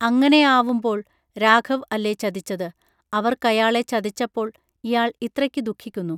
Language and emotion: Malayalam, neutral